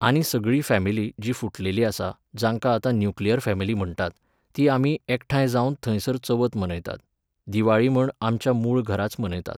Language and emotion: Goan Konkani, neutral